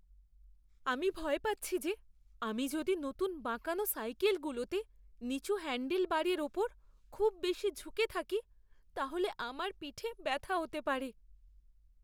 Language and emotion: Bengali, fearful